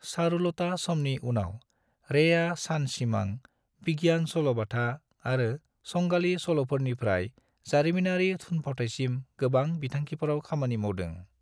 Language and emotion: Bodo, neutral